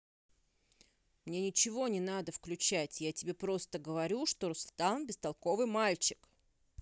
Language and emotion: Russian, angry